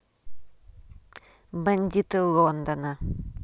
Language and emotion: Russian, neutral